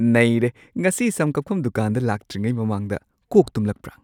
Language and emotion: Manipuri, surprised